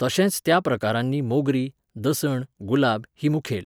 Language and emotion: Goan Konkani, neutral